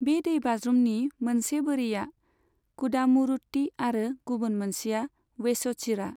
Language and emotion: Bodo, neutral